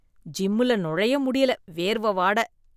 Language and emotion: Tamil, disgusted